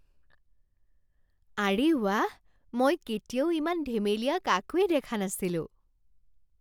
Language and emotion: Assamese, surprised